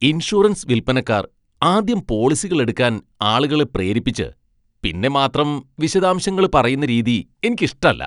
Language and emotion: Malayalam, disgusted